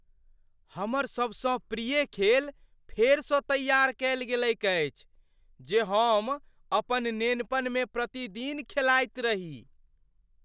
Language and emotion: Maithili, surprised